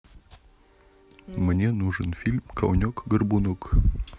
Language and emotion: Russian, neutral